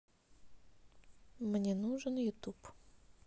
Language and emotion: Russian, neutral